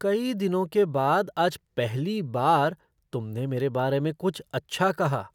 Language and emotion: Hindi, surprised